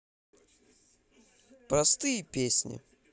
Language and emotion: Russian, positive